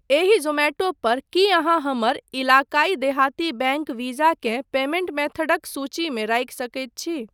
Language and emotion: Maithili, neutral